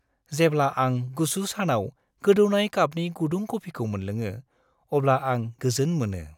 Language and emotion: Bodo, happy